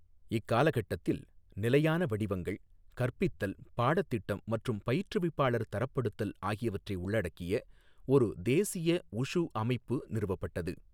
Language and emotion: Tamil, neutral